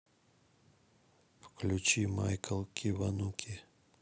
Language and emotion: Russian, neutral